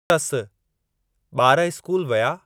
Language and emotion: Sindhi, neutral